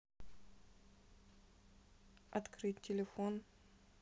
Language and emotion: Russian, neutral